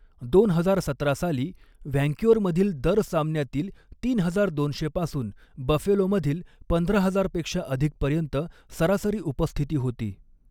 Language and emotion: Marathi, neutral